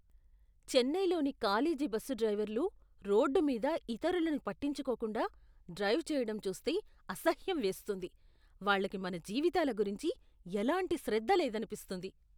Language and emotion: Telugu, disgusted